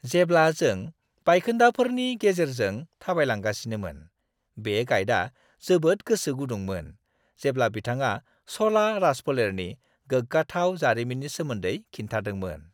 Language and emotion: Bodo, happy